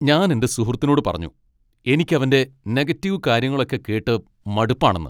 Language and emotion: Malayalam, angry